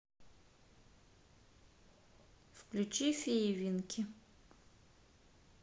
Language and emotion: Russian, neutral